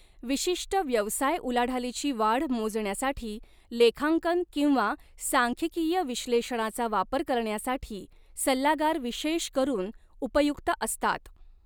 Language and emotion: Marathi, neutral